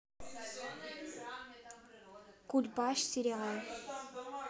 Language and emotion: Russian, neutral